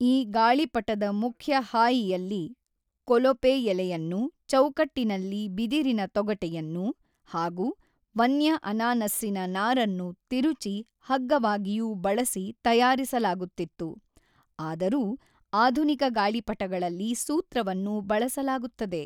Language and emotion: Kannada, neutral